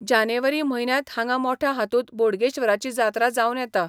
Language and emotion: Goan Konkani, neutral